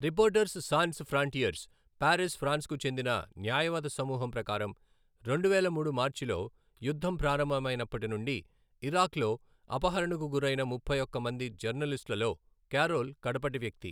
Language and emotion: Telugu, neutral